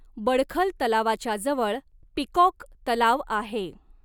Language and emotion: Marathi, neutral